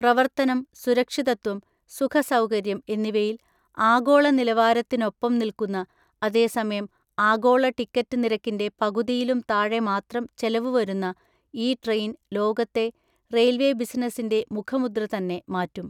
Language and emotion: Malayalam, neutral